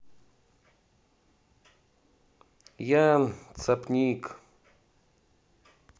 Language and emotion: Russian, neutral